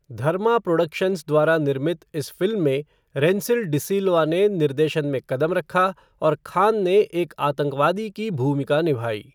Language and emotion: Hindi, neutral